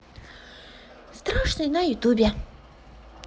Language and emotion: Russian, positive